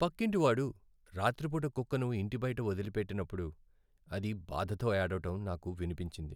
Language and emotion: Telugu, sad